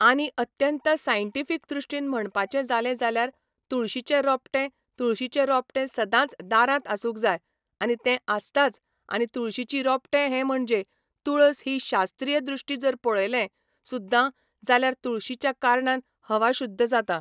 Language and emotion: Goan Konkani, neutral